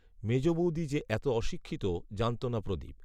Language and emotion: Bengali, neutral